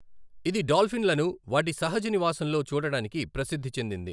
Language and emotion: Telugu, neutral